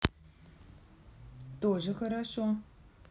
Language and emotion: Russian, positive